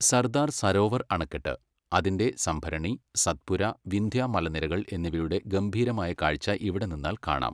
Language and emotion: Malayalam, neutral